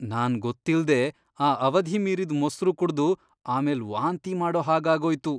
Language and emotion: Kannada, disgusted